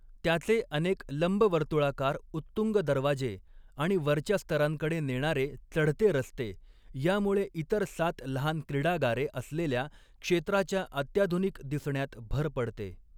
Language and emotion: Marathi, neutral